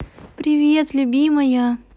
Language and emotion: Russian, positive